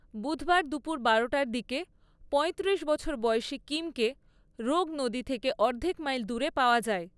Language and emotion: Bengali, neutral